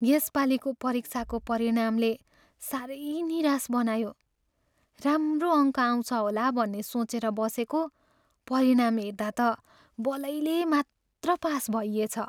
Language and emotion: Nepali, sad